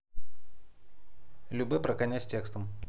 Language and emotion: Russian, neutral